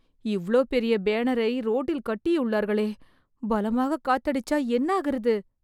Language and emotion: Tamil, fearful